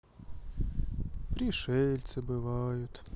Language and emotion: Russian, sad